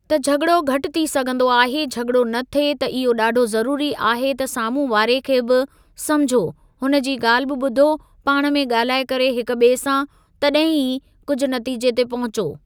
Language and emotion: Sindhi, neutral